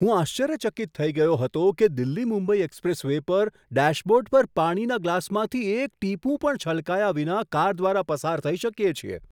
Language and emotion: Gujarati, surprised